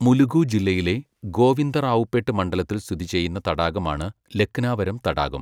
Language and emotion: Malayalam, neutral